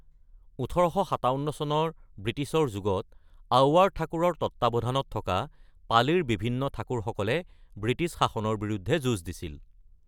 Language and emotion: Assamese, neutral